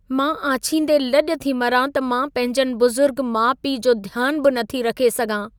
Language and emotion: Sindhi, sad